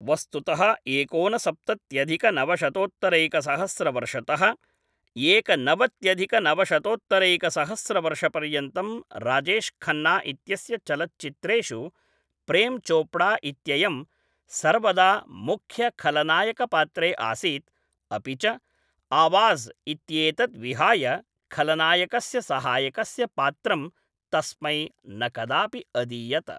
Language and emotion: Sanskrit, neutral